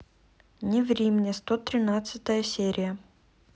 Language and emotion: Russian, neutral